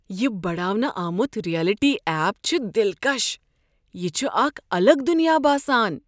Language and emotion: Kashmiri, surprised